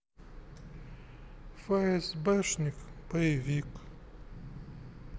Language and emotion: Russian, sad